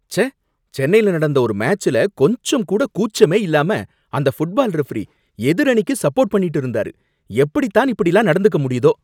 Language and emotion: Tamil, angry